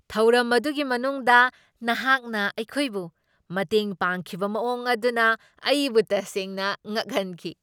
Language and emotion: Manipuri, surprised